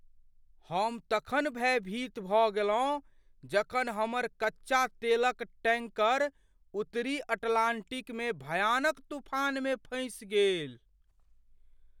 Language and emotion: Maithili, fearful